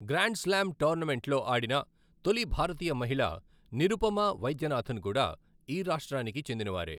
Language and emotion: Telugu, neutral